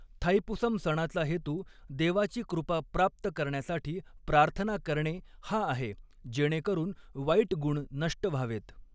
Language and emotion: Marathi, neutral